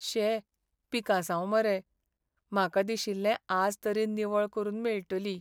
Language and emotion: Goan Konkani, sad